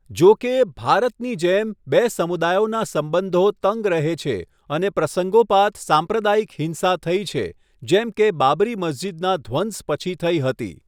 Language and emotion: Gujarati, neutral